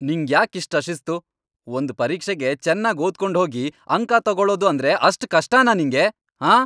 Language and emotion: Kannada, angry